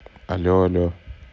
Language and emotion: Russian, neutral